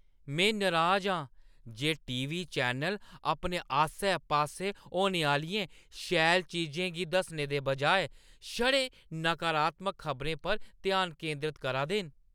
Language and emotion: Dogri, angry